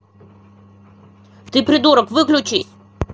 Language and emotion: Russian, angry